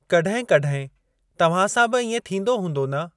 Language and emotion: Sindhi, neutral